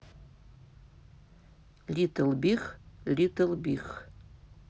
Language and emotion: Russian, neutral